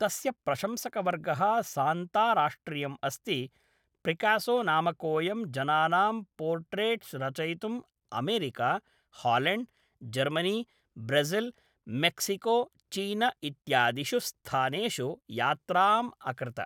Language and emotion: Sanskrit, neutral